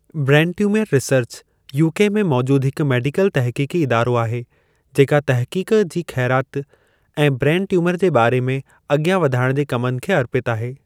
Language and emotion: Sindhi, neutral